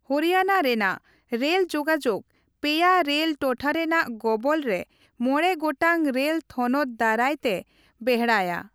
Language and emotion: Santali, neutral